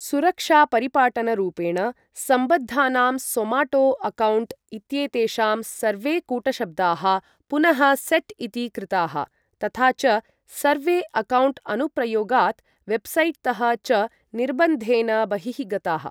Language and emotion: Sanskrit, neutral